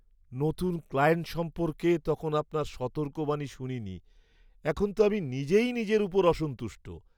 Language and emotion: Bengali, sad